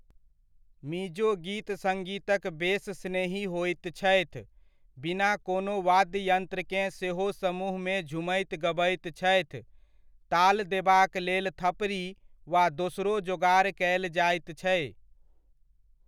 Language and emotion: Maithili, neutral